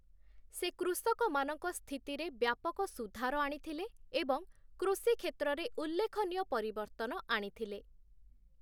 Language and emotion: Odia, neutral